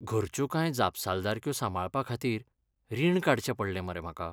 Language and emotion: Goan Konkani, sad